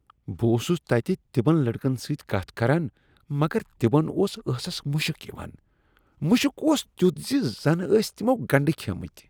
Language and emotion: Kashmiri, disgusted